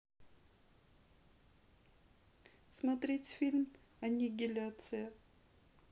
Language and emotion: Russian, sad